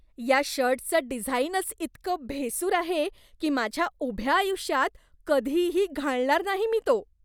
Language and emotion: Marathi, disgusted